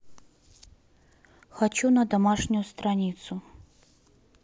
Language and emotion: Russian, neutral